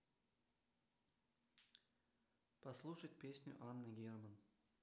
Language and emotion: Russian, neutral